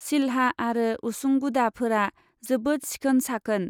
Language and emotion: Bodo, neutral